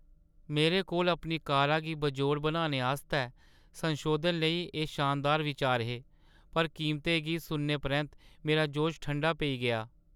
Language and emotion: Dogri, sad